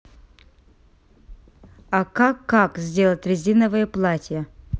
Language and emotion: Russian, neutral